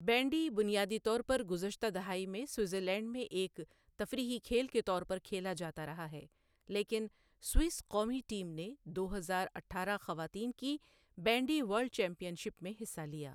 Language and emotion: Urdu, neutral